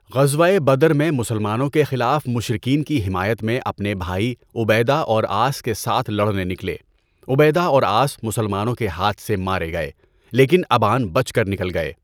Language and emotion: Urdu, neutral